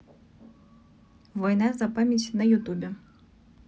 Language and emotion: Russian, neutral